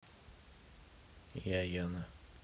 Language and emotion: Russian, neutral